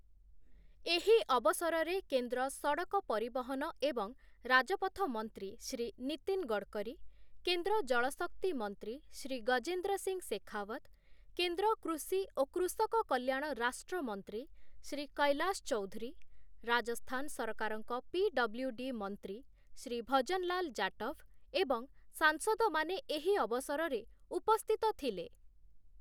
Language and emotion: Odia, neutral